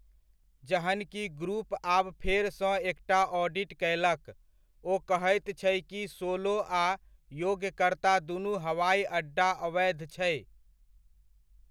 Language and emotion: Maithili, neutral